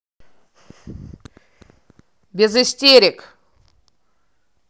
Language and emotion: Russian, angry